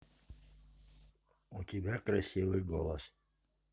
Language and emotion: Russian, positive